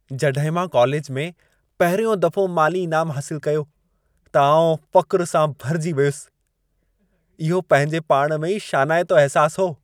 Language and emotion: Sindhi, happy